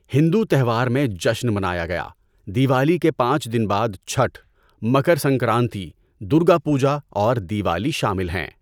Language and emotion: Urdu, neutral